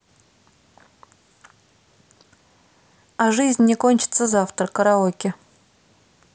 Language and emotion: Russian, neutral